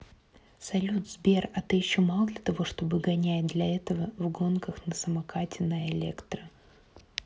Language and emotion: Russian, neutral